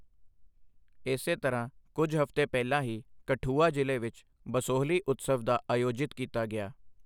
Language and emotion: Punjabi, neutral